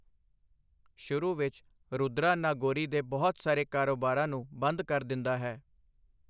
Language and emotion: Punjabi, neutral